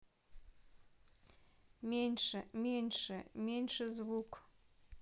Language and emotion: Russian, neutral